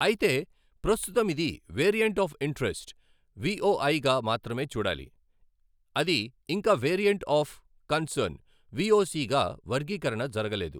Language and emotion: Telugu, neutral